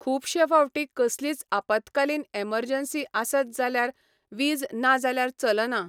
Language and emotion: Goan Konkani, neutral